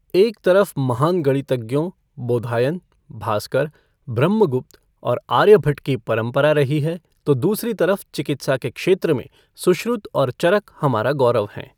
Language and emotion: Hindi, neutral